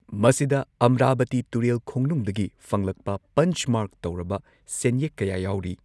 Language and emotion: Manipuri, neutral